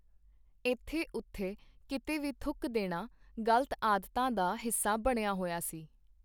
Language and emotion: Punjabi, neutral